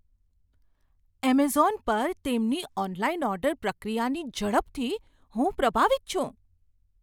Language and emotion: Gujarati, surprised